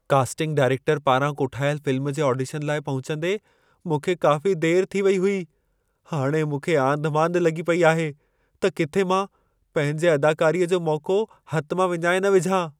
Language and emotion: Sindhi, fearful